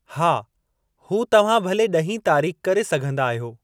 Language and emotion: Sindhi, neutral